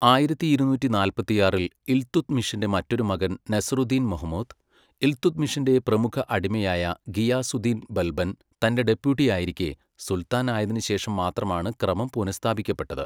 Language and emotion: Malayalam, neutral